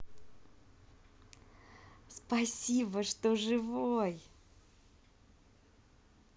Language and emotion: Russian, positive